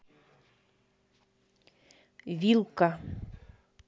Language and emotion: Russian, neutral